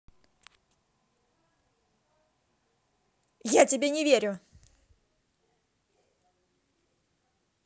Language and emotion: Russian, angry